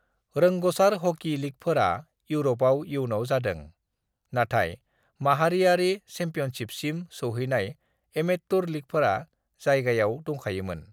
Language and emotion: Bodo, neutral